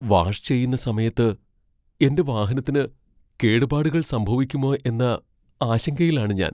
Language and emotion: Malayalam, fearful